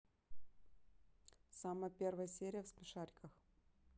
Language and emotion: Russian, neutral